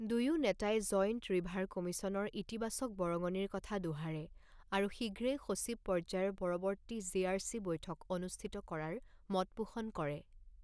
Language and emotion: Assamese, neutral